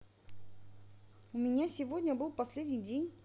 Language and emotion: Russian, neutral